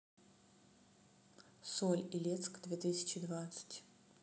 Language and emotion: Russian, neutral